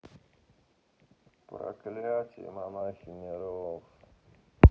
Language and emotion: Russian, sad